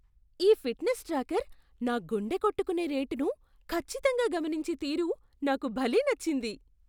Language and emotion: Telugu, surprised